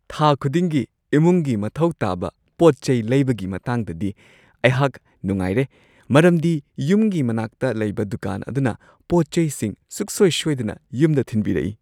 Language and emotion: Manipuri, happy